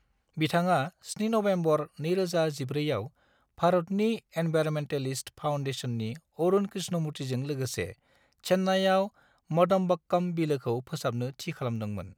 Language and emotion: Bodo, neutral